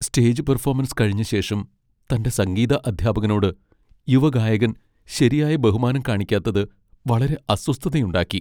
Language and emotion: Malayalam, sad